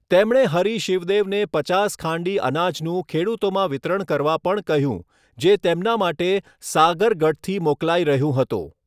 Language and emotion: Gujarati, neutral